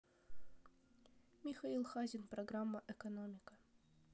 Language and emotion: Russian, neutral